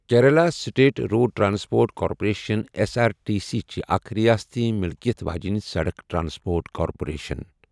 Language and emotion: Kashmiri, neutral